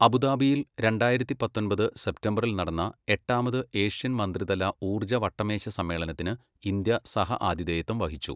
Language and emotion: Malayalam, neutral